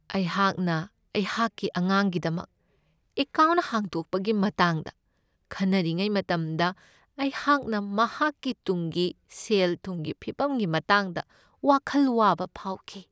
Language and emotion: Manipuri, sad